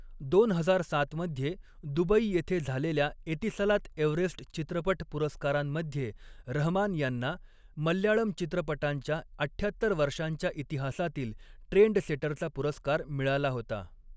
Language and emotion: Marathi, neutral